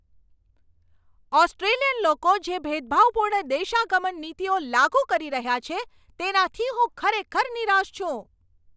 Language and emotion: Gujarati, angry